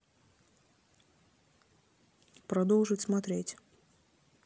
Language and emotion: Russian, neutral